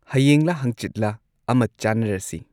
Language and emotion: Manipuri, neutral